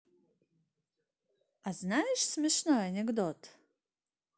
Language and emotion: Russian, neutral